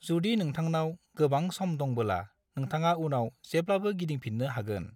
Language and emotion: Bodo, neutral